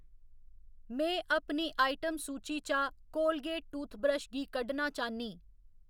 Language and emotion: Dogri, neutral